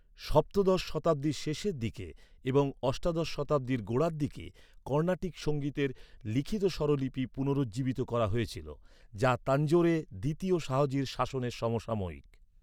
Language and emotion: Bengali, neutral